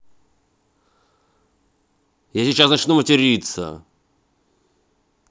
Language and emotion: Russian, angry